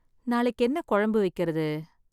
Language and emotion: Tamil, sad